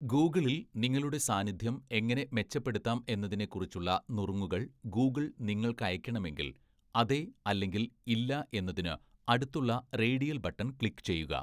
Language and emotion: Malayalam, neutral